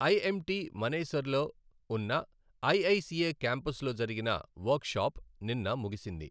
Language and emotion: Telugu, neutral